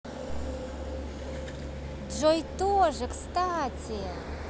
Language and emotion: Russian, positive